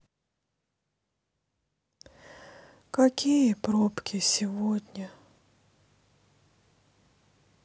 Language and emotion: Russian, sad